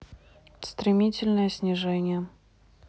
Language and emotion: Russian, neutral